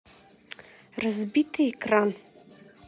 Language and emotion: Russian, neutral